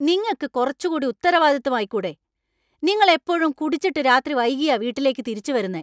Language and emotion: Malayalam, angry